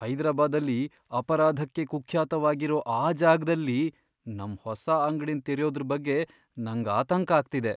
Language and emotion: Kannada, fearful